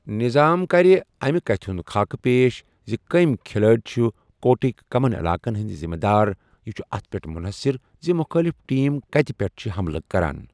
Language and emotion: Kashmiri, neutral